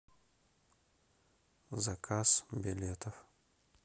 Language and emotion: Russian, neutral